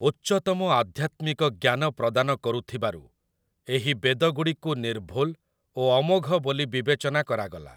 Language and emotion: Odia, neutral